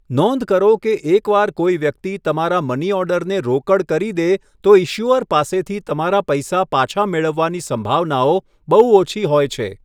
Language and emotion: Gujarati, neutral